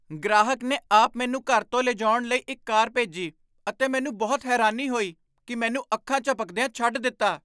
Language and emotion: Punjabi, surprised